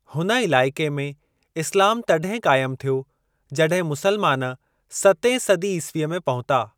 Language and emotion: Sindhi, neutral